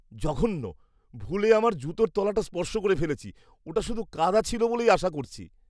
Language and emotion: Bengali, disgusted